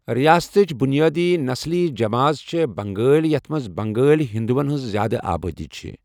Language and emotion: Kashmiri, neutral